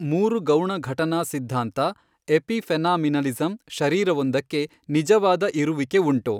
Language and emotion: Kannada, neutral